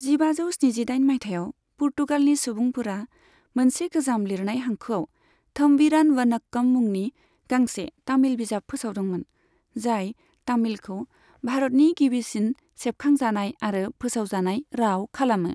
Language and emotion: Bodo, neutral